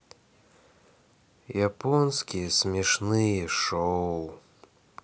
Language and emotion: Russian, sad